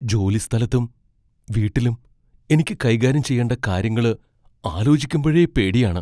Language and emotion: Malayalam, fearful